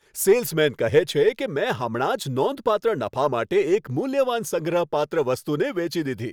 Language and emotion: Gujarati, happy